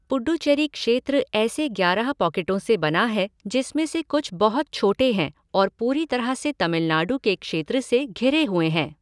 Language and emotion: Hindi, neutral